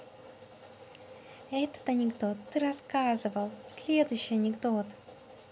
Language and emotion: Russian, positive